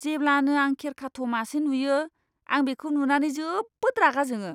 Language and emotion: Bodo, disgusted